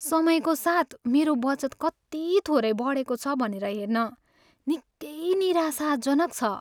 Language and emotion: Nepali, sad